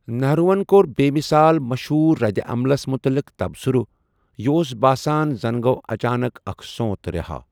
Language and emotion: Kashmiri, neutral